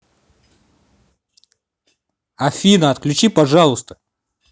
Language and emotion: Russian, angry